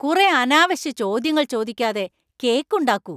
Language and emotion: Malayalam, angry